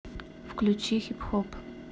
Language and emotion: Russian, neutral